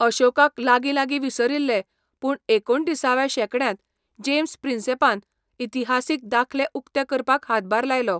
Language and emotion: Goan Konkani, neutral